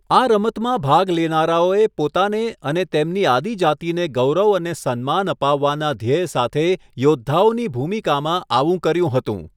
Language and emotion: Gujarati, neutral